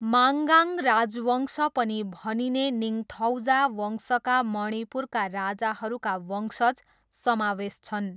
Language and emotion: Nepali, neutral